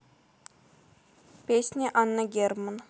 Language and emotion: Russian, neutral